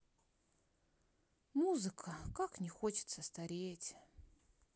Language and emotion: Russian, sad